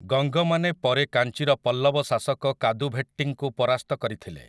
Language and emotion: Odia, neutral